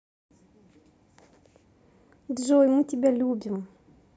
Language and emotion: Russian, positive